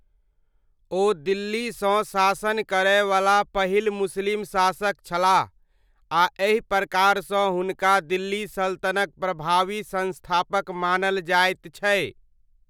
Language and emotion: Maithili, neutral